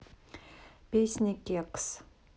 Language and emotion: Russian, neutral